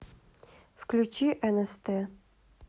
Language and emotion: Russian, neutral